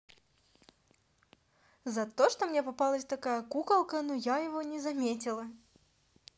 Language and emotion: Russian, positive